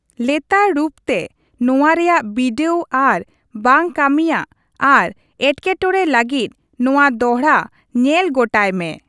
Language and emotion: Santali, neutral